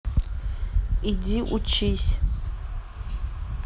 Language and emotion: Russian, neutral